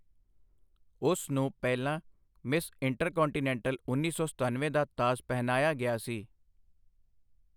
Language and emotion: Punjabi, neutral